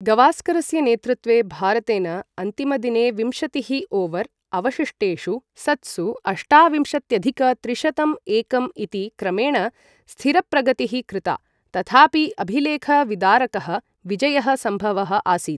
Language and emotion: Sanskrit, neutral